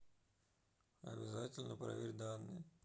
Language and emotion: Russian, neutral